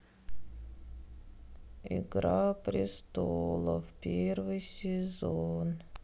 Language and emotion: Russian, sad